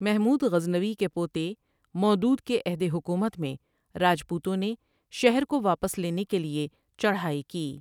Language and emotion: Urdu, neutral